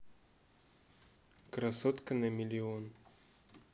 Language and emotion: Russian, neutral